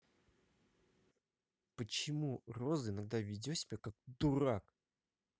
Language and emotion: Russian, angry